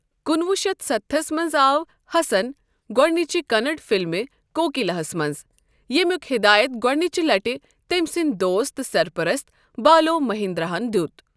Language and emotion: Kashmiri, neutral